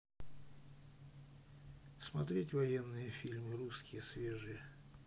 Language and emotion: Russian, neutral